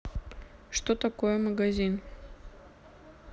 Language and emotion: Russian, neutral